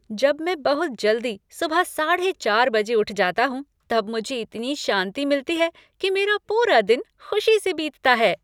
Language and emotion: Hindi, happy